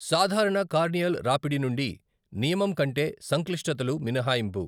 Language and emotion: Telugu, neutral